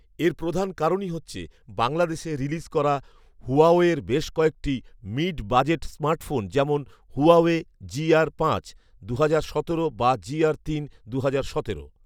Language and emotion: Bengali, neutral